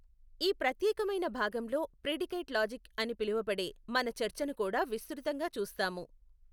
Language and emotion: Telugu, neutral